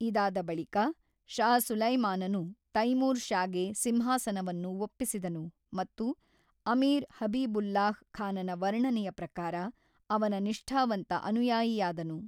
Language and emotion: Kannada, neutral